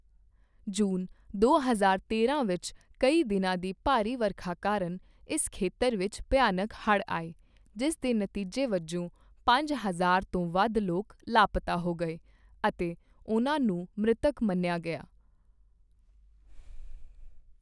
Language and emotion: Punjabi, neutral